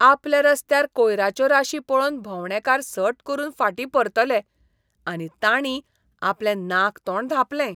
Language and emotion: Goan Konkani, disgusted